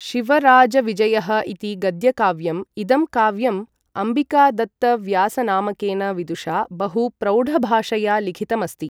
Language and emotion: Sanskrit, neutral